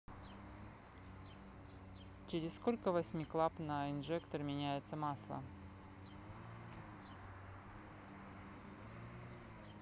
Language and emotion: Russian, neutral